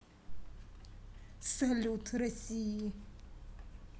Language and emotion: Russian, neutral